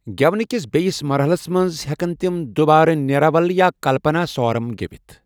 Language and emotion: Kashmiri, neutral